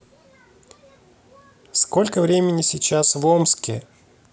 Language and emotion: Russian, neutral